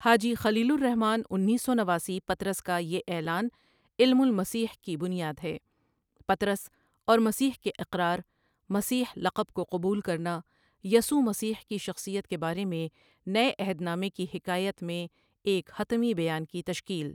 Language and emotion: Urdu, neutral